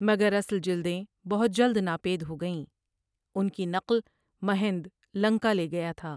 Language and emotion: Urdu, neutral